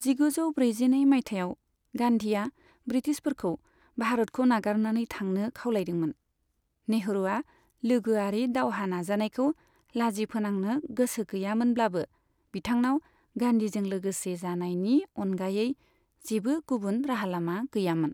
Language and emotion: Bodo, neutral